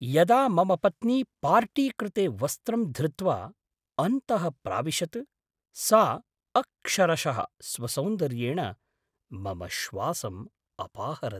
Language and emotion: Sanskrit, surprised